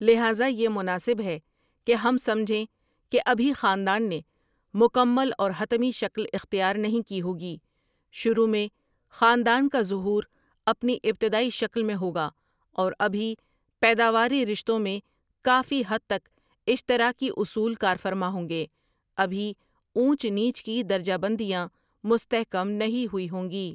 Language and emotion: Urdu, neutral